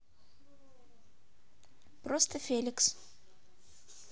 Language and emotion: Russian, neutral